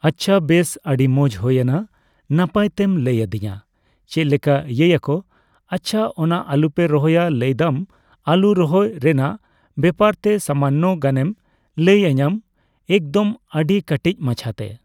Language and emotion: Santali, neutral